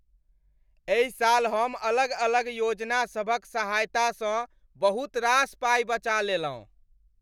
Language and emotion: Maithili, happy